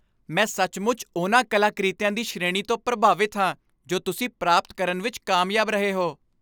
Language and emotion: Punjabi, happy